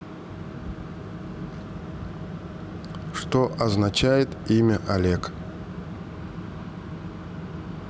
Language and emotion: Russian, neutral